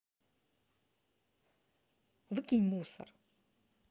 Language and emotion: Russian, angry